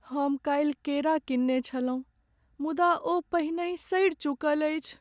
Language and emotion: Maithili, sad